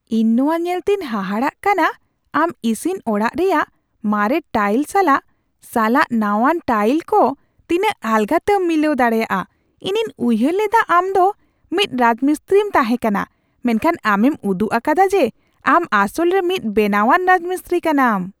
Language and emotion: Santali, surprised